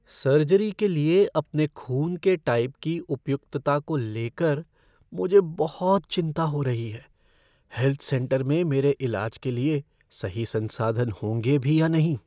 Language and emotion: Hindi, fearful